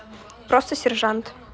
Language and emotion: Russian, neutral